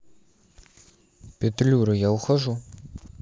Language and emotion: Russian, neutral